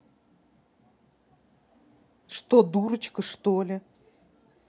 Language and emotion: Russian, angry